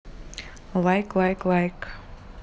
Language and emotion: Russian, neutral